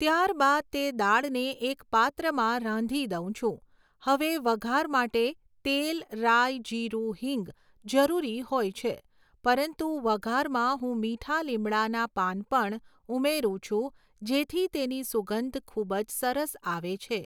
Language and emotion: Gujarati, neutral